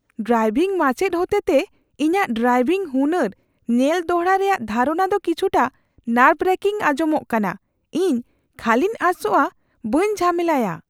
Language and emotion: Santali, fearful